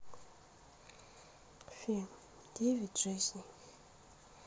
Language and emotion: Russian, sad